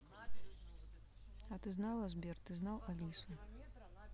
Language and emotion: Russian, neutral